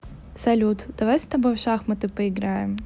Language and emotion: Russian, neutral